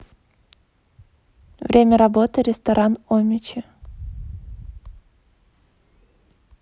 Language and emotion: Russian, neutral